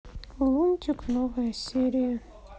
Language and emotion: Russian, sad